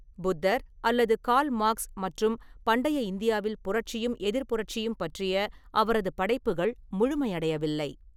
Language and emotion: Tamil, neutral